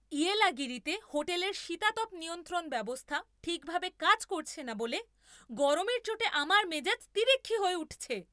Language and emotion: Bengali, angry